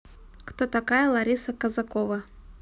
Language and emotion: Russian, neutral